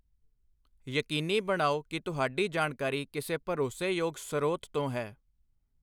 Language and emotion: Punjabi, neutral